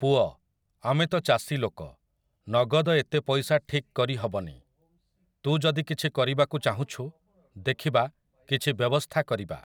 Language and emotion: Odia, neutral